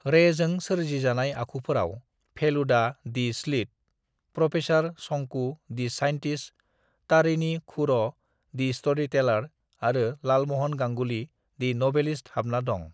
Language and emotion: Bodo, neutral